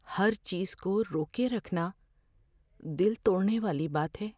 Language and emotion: Urdu, fearful